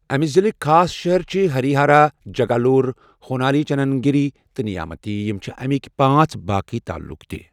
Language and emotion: Kashmiri, neutral